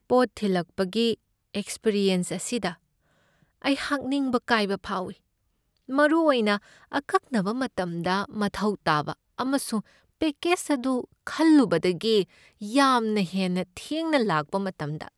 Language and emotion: Manipuri, sad